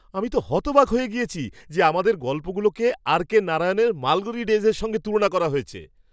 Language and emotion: Bengali, surprised